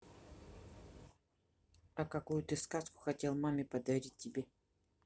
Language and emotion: Russian, neutral